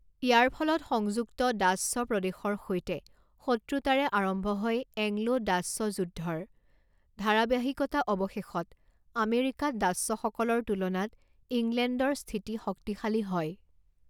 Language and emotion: Assamese, neutral